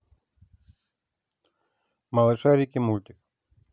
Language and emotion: Russian, neutral